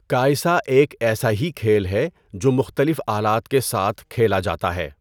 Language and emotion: Urdu, neutral